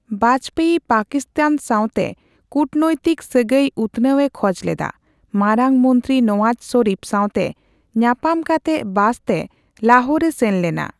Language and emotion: Santali, neutral